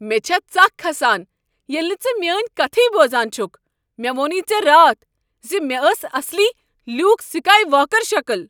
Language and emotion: Kashmiri, angry